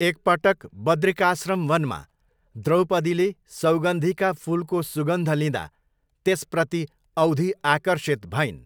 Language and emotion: Nepali, neutral